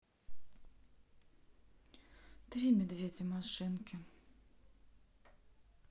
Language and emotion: Russian, sad